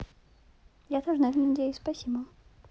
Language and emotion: Russian, neutral